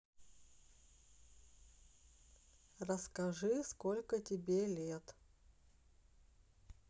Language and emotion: Russian, neutral